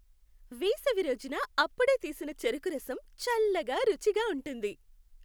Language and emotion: Telugu, happy